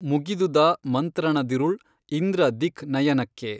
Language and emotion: Kannada, neutral